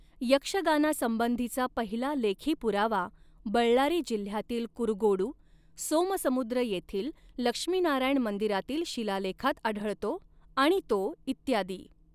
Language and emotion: Marathi, neutral